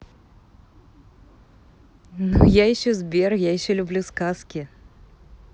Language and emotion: Russian, positive